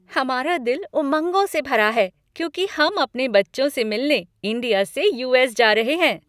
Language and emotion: Hindi, happy